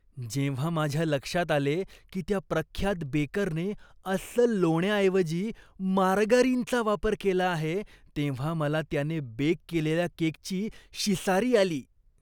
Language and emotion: Marathi, disgusted